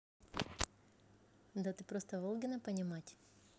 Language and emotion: Russian, positive